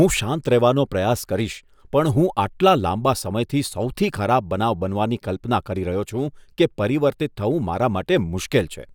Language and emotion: Gujarati, disgusted